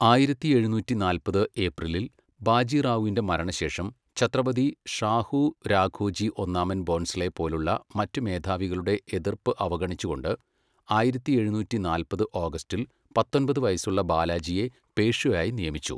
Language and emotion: Malayalam, neutral